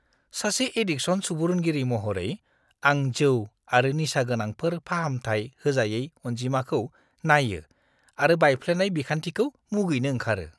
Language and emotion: Bodo, disgusted